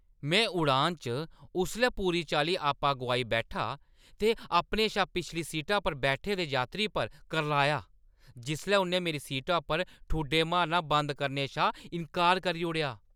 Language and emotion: Dogri, angry